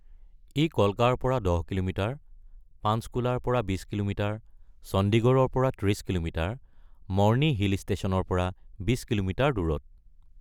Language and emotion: Assamese, neutral